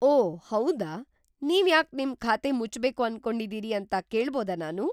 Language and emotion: Kannada, surprised